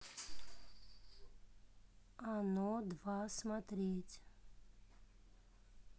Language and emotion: Russian, neutral